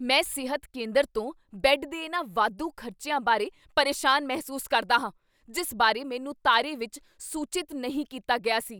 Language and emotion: Punjabi, angry